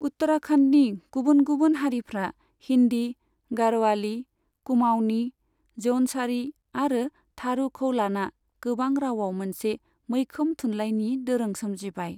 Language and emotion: Bodo, neutral